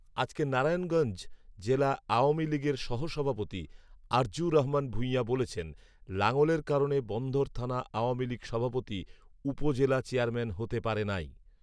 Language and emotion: Bengali, neutral